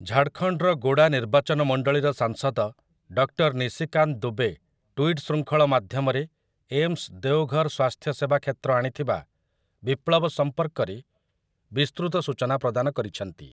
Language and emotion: Odia, neutral